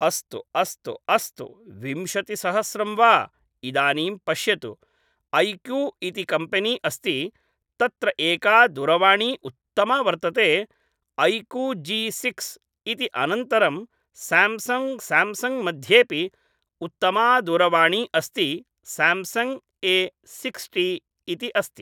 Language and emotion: Sanskrit, neutral